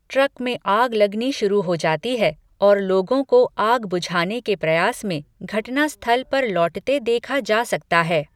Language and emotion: Hindi, neutral